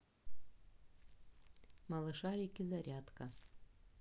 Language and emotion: Russian, neutral